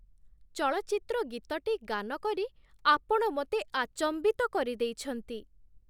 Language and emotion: Odia, surprised